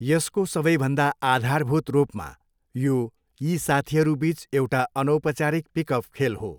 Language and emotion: Nepali, neutral